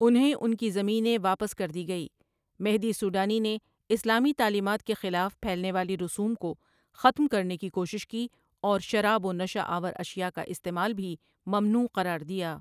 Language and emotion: Urdu, neutral